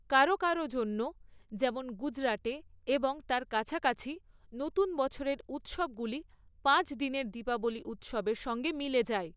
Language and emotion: Bengali, neutral